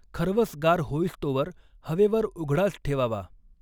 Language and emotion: Marathi, neutral